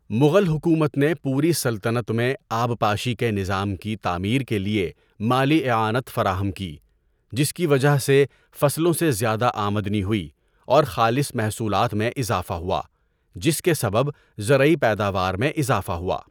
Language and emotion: Urdu, neutral